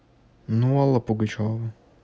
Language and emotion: Russian, neutral